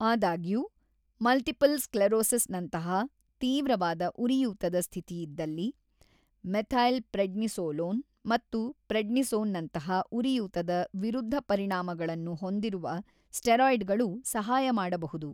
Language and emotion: Kannada, neutral